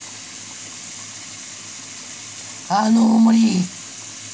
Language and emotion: Russian, angry